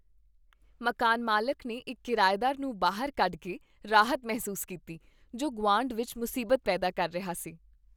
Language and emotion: Punjabi, happy